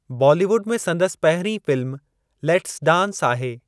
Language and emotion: Sindhi, neutral